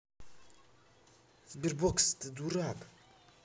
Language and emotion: Russian, angry